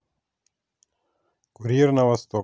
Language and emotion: Russian, neutral